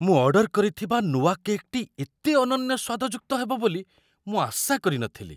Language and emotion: Odia, surprised